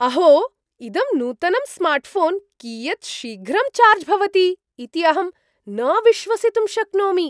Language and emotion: Sanskrit, surprised